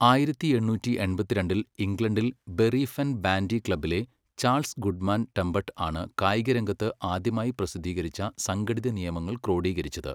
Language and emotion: Malayalam, neutral